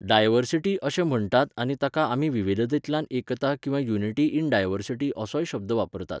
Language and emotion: Goan Konkani, neutral